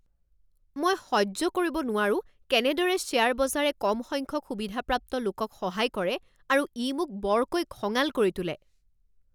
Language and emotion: Assamese, angry